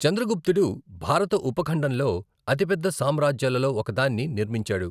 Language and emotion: Telugu, neutral